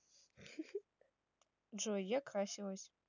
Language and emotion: Russian, neutral